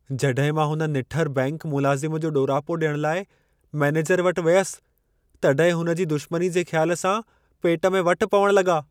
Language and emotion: Sindhi, fearful